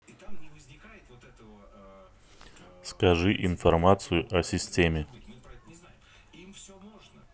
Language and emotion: Russian, neutral